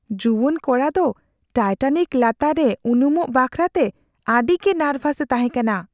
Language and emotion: Santali, fearful